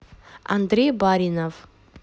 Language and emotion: Russian, neutral